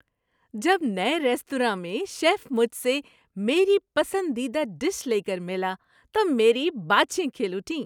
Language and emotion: Urdu, happy